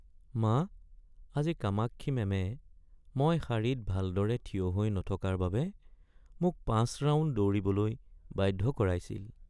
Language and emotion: Assamese, sad